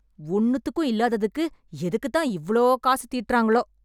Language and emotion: Tamil, angry